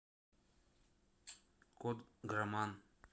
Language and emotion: Russian, neutral